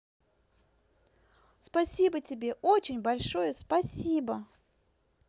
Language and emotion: Russian, positive